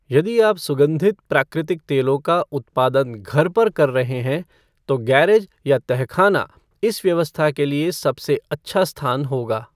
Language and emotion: Hindi, neutral